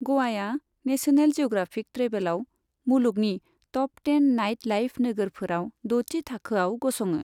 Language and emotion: Bodo, neutral